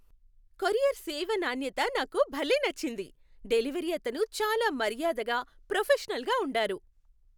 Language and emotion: Telugu, happy